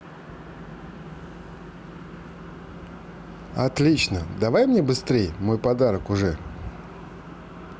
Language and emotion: Russian, positive